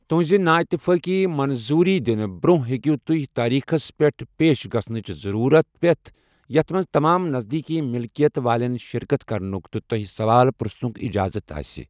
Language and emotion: Kashmiri, neutral